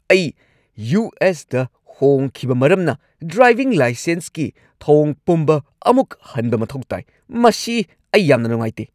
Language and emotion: Manipuri, angry